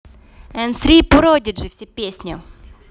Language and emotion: Russian, neutral